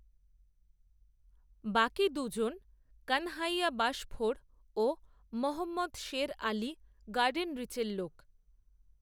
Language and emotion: Bengali, neutral